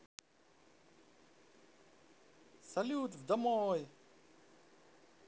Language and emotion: Russian, positive